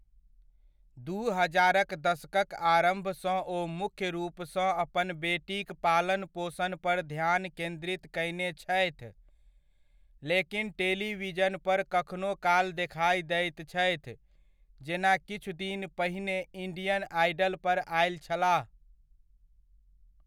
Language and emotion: Maithili, neutral